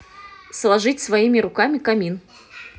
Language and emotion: Russian, neutral